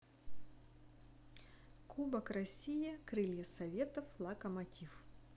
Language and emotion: Russian, neutral